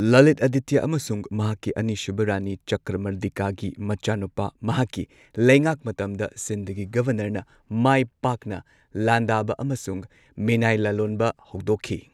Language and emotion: Manipuri, neutral